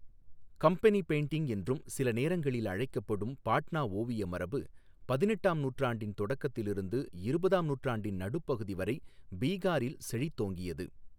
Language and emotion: Tamil, neutral